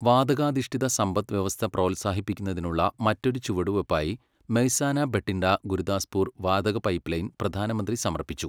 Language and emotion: Malayalam, neutral